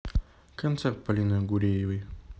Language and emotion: Russian, neutral